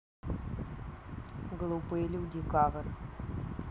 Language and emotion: Russian, neutral